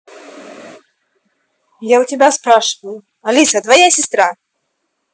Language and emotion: Russian, angry